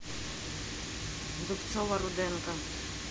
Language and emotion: Russian, neutral